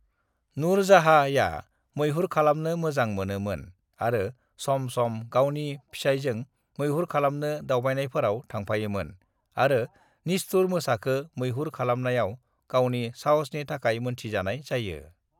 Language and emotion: Bodo, neutral